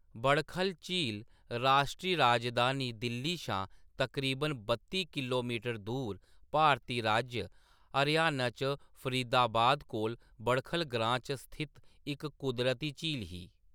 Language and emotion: Dogri, neutral